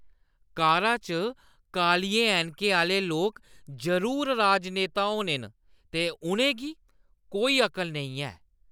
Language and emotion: Dogri, disgusted